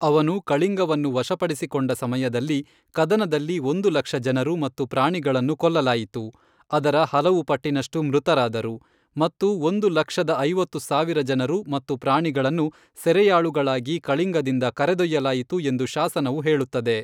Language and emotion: Kannada, neutral